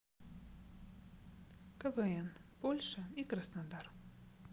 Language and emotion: Russian, neutral